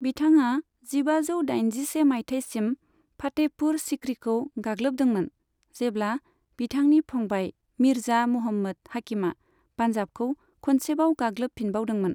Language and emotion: Bodo, neutral